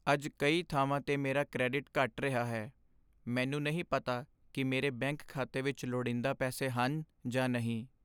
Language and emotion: Punjabi, sad